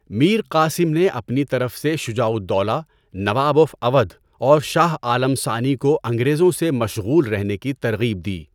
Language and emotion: Urdu, neutral